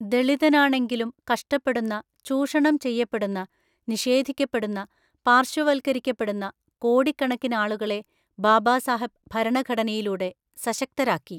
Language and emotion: Malayalam, neutral